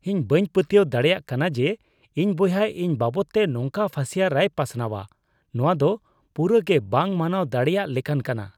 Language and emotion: Santali, disgusted